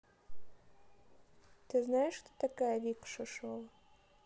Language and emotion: Russian, neutral